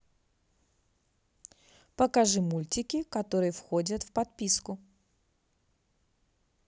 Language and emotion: Russian, positive